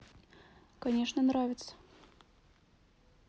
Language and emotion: Russian, neutral